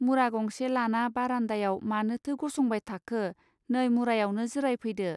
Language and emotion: Bodo, neutral